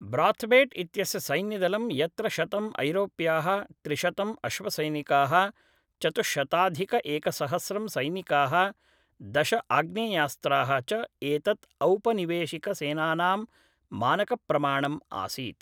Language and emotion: Sanskrit, neutral